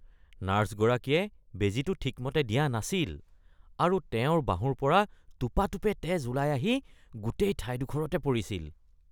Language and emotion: Assamese, disgusted